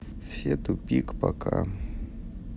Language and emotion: Russian, sad